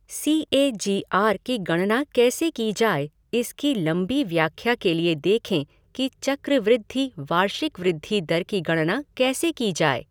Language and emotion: Hindi, neutral